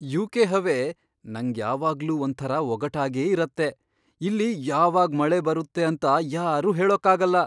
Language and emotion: Kannada, surprised